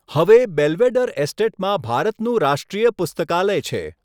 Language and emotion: Gujarati, neutral